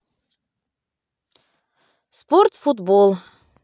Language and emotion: Russian, positive